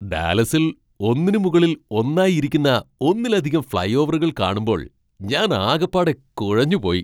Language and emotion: Malayalam, surprised